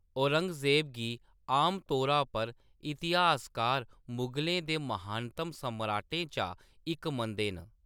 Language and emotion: Dogri, neutral